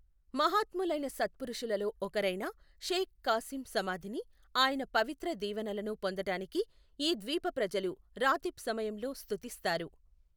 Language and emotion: Telugu, neutral